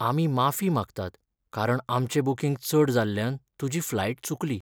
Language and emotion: Goan Konkani, sad